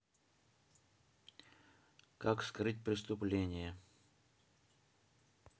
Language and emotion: Russian, neutral